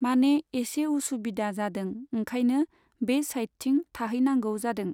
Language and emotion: Bodo, neutral